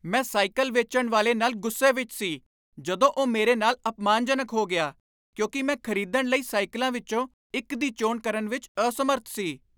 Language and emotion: Punjabi, angry